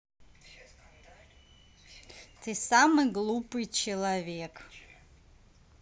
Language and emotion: Russian, neutral